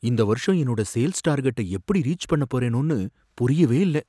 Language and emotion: Tamil, fearful